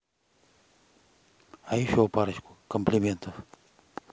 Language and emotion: Russian, neutral